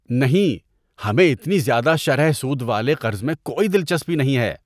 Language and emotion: Urdu, disgusted